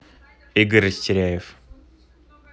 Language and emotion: Russian, neutral